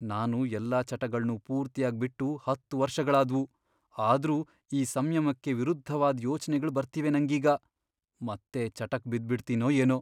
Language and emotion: Kannada, fearful